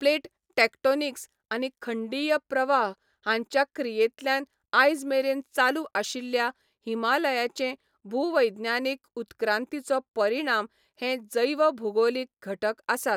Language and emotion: Goan Konkani, neutral